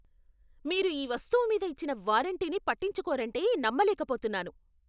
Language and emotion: Telugu, angry